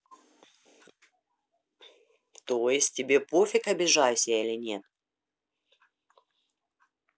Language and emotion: Russian, neutral